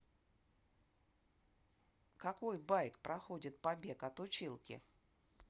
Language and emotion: Russian, neutral